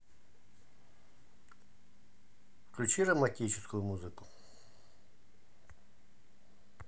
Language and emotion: Russian, neutral